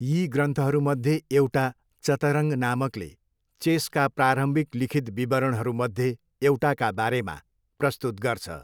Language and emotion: Nepali, neutral